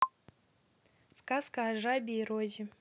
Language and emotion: Russian, positive